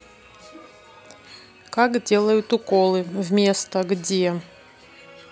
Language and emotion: Russian, neutral